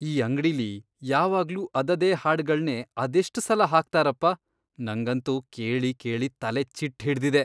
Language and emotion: Kannada, disgusted